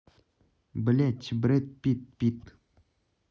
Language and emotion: Russian, neutral